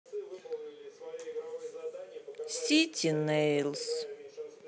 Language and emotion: Russian, sad